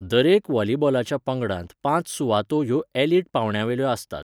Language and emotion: Goan Konkani, neutral